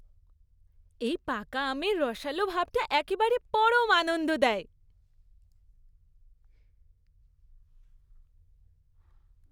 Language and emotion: Bengali, happy